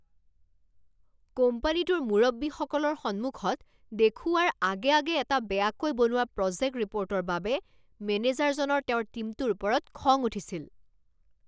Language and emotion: Assamese, angry